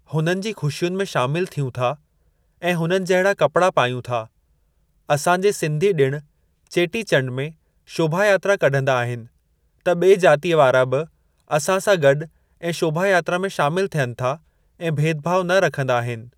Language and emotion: Sindhi, neutral